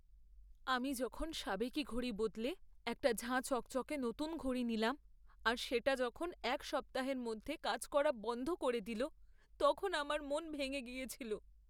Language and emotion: Bengali, sad